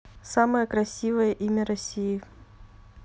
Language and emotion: Russian, neutral